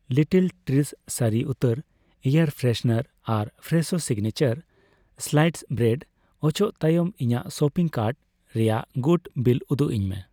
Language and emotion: Santali, neutral